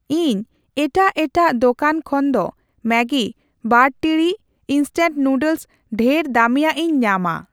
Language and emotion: Santali, neutral